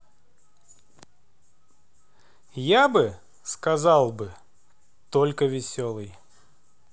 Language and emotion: Russian, positive